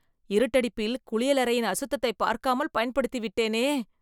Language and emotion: Tamil, disgusted